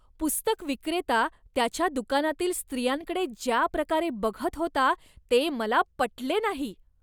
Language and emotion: Marathi, disgusted